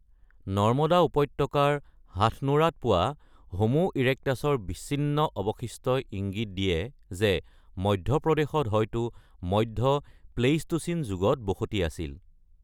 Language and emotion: Assamese, neutral